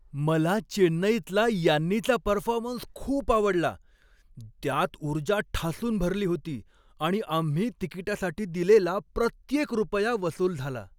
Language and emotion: Marathi, happy